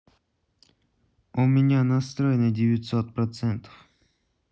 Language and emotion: Russian, neutral